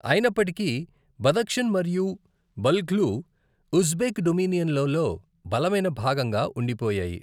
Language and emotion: Telugu, neutral